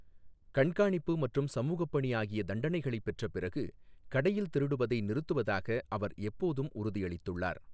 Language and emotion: Tamil, neutral